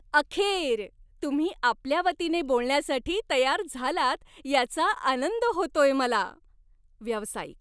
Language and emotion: Marathi, happy